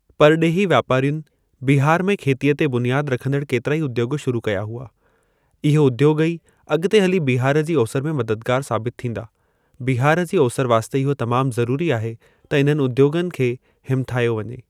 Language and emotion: Sindhi, neutral